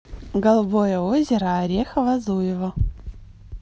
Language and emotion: Russian, positive